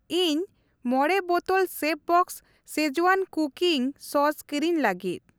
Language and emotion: Santali, neutral